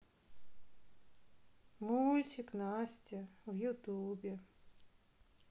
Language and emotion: Russian, sad